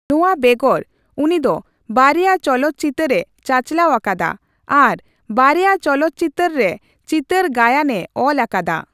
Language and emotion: Santali, neutral